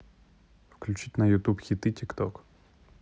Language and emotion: Russian, neutral